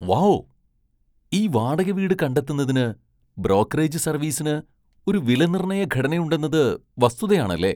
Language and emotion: Malayalam, surprised